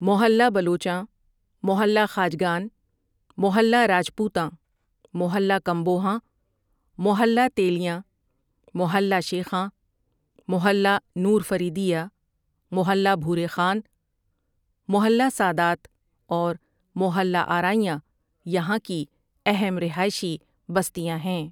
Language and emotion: Urdu, neutral